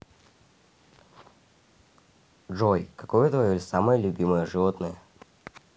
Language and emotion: Russian, neutral